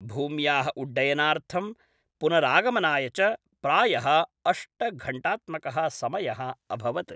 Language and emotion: Sanskrit, neutral